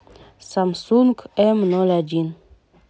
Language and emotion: Russian, neutral